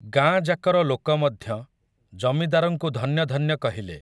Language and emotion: Odia, neutral